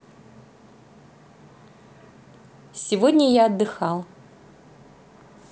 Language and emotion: Russian, positive